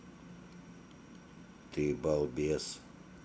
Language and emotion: Russian, neutral